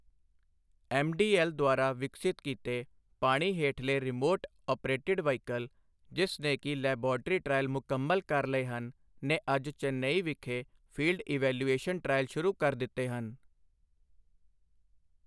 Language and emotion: Punjabi, neutral